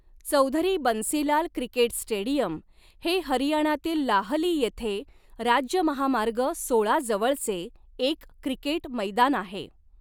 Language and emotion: Marathi, neutral